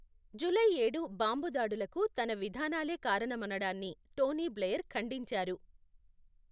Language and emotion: Telugu, neutral